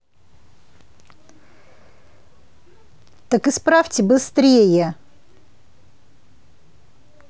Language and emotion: Russian, angry